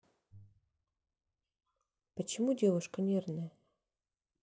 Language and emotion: Russian, neutral